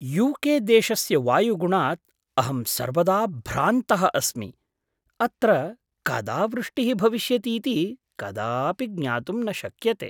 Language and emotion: Sanskrit, surprised